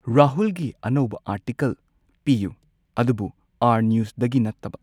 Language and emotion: Manipuri, neutral